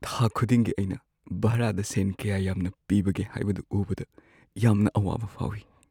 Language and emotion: Manipuri, sad